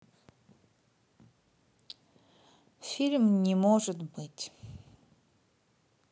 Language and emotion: Russian, neutral